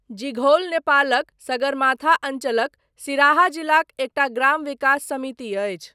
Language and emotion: Maithili, neutral